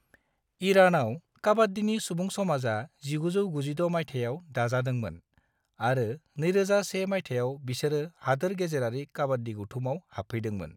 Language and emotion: Bodo, neutral